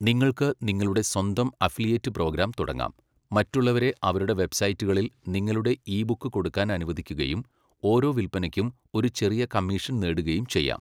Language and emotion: Malayalam, neutral